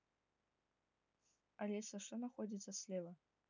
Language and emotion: Russian, neutral